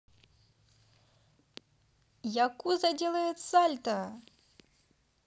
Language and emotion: Russian, positive